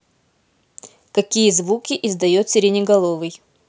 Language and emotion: Russian, neutral